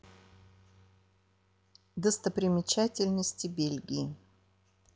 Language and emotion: Russian, neutral